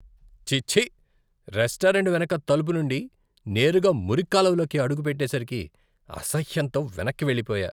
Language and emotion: Telugu, disgusted